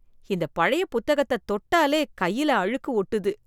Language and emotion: Tamil, disgusted